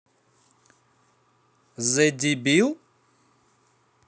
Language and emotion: Russian, neutral